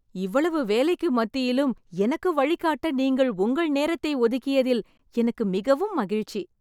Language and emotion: Tamil, happy